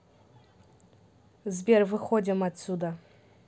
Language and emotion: Russian, neutral